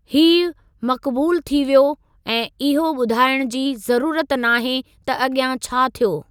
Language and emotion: Sindhi, neutral